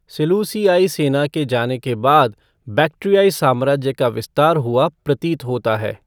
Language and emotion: Hindi, neutral